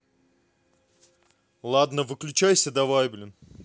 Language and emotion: Russian, neutral